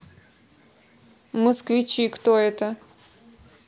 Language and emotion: Russian, neutral